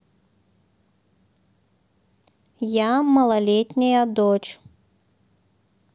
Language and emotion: Russian, neutral